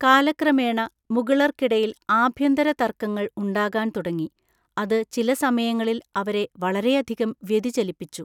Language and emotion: Malayalam, neutral